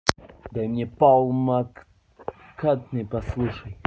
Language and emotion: Russian, angry